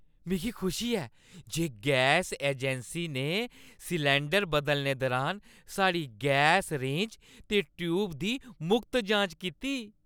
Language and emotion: Dogri, happy